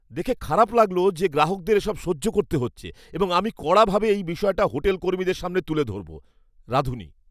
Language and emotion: Bengali, angry